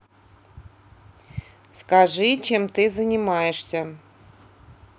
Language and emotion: Russian, neutral